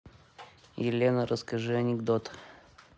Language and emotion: Russian, neutral